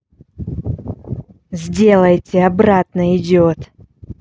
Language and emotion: Russian, angry